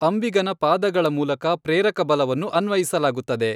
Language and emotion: Kannada, neutral